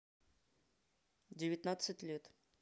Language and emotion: Russian, neutral